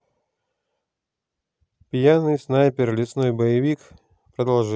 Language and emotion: Russian, neutral